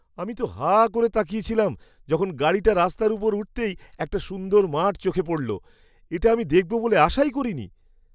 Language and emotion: Bengali, surprised